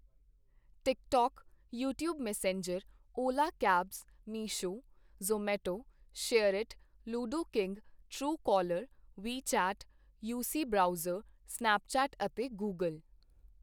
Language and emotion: Punjabi, neutral